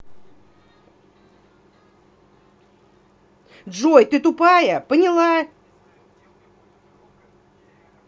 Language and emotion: Russian, angry